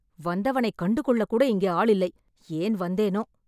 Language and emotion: Tamil, angry